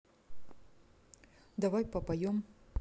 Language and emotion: Russian, neutral